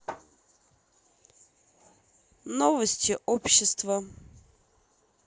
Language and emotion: Russian, neutral